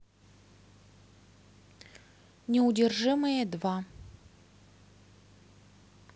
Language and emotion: Russian, neutral